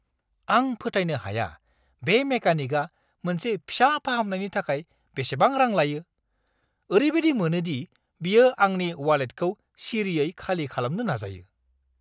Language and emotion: Bodo, angry